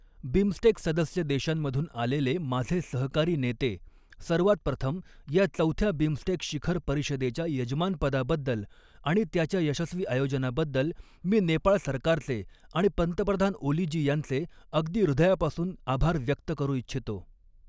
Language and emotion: Marathi, neutral